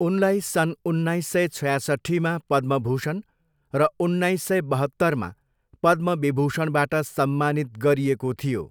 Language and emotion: Nepali, neutral